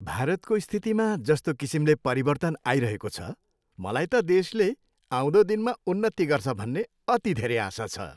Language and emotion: Nepali, happy